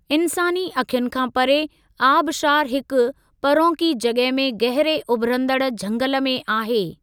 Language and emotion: Sindhi, neutral